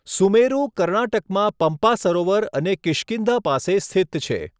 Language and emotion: Gujarati, neutral